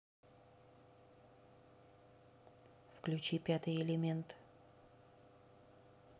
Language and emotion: Russian, neutral